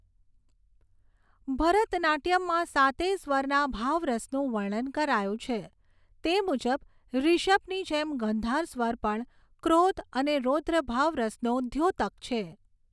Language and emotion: Gujarati, neutral